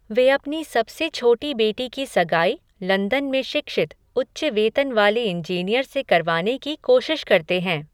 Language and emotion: Hindi, neutral